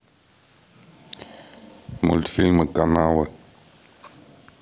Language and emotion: Russian, neutral